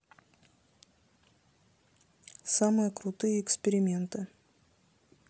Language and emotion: Russian, neutral